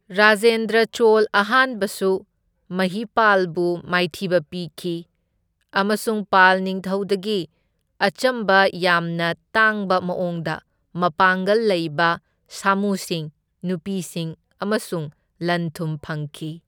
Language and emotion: Manipuri, neutral